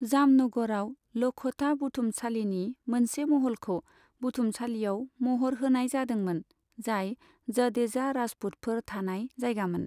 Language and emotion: Bodo, neutral